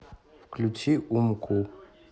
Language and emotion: Russian, neutral